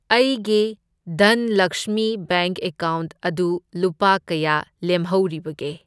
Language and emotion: Manipuri, neutral